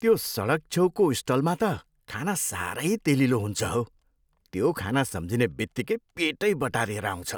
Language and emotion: Nepali, disgusted